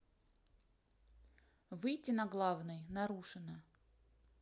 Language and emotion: Russian, neutral